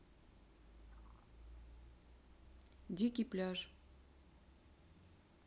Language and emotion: Russian, neutral